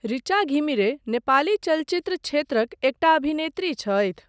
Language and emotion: Maithili, neutral